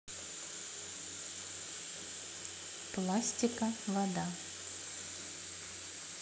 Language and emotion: Russian, neutral